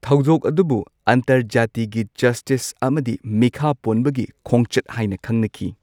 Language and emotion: Manipuri, neutral